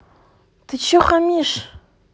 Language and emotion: Russian, angry